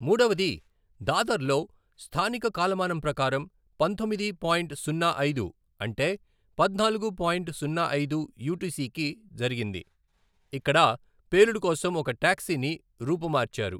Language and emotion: Telugu, neutral